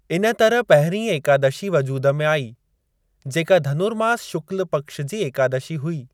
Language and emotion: Sindhi, neutral